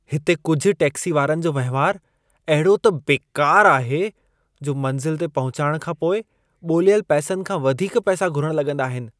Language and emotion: Sindhi, disgusted